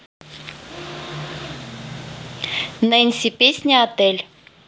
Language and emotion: Russian, neutral